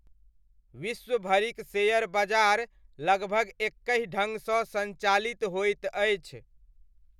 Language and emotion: Maithili, neutral